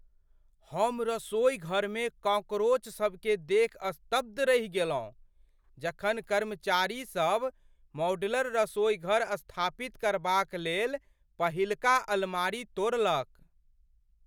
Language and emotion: Maithili, surprised